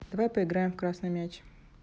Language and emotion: Russian, neutral